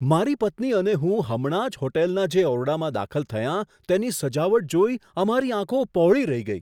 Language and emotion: Gujarati, surprised